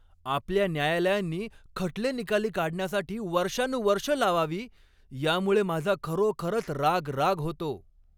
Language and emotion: Marathi, angry